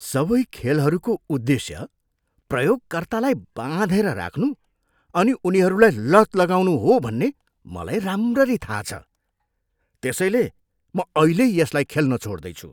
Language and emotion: Nepali, disgusted